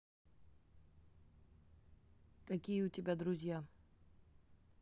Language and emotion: Russian, neutral